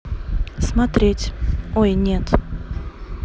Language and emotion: Russian, neutral